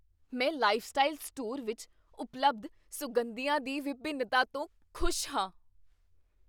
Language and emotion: Punjabi, surprised